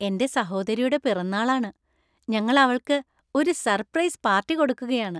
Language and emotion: Malayalam, happy